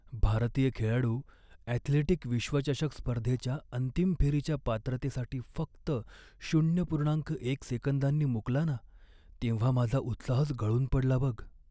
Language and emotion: Marathi, sad